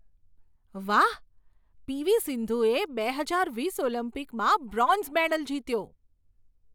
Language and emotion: Gujarati, surprised